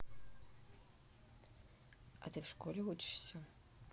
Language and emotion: Russian, neutral